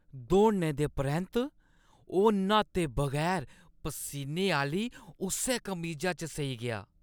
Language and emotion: Dogri, disgusted